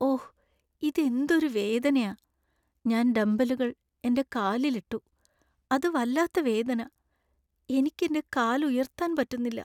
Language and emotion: Malayalam, sad